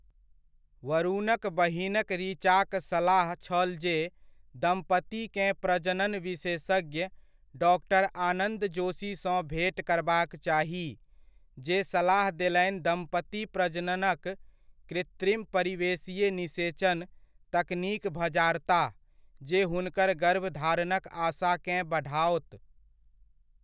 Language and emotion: Maithili, neutral